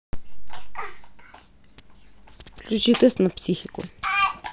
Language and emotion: Russian, neutral